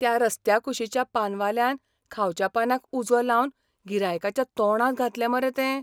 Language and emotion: Goan Konkani, surprised